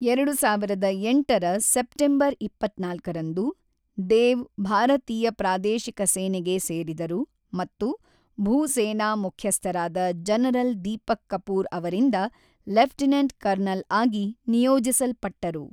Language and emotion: Kannada, neutral